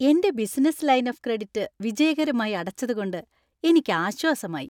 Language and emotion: Malayalam, happy